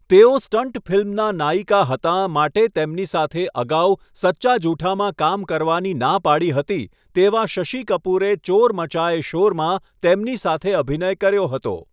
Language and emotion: Gujarati, neutral